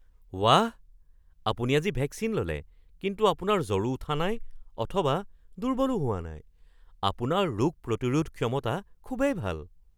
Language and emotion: Assamese, surprised